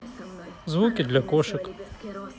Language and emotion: Russian, neutral